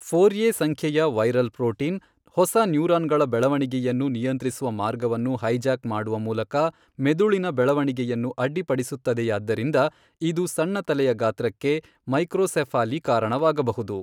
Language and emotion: Kannada, neutral